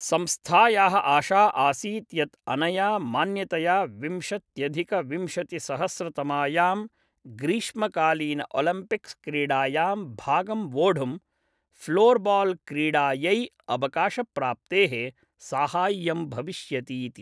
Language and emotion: Sanskrit, neutral